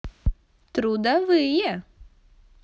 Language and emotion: Russian, positive